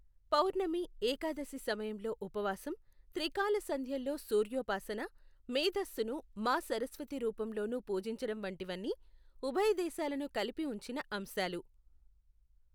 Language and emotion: Telugu, neutral